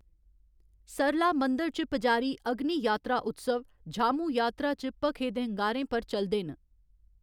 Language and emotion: Dogri, neutral